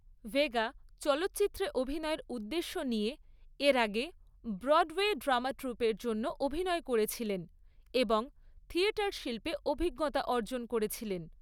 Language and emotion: Bengali, neutral